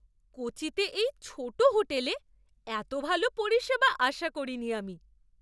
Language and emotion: Bengali, surprised